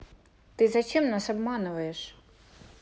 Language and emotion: Russian, neutral